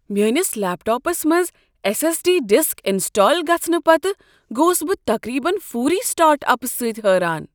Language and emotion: Kashmiri, surprised